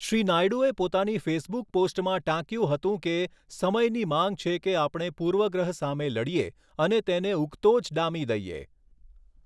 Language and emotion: Gujarati, neutral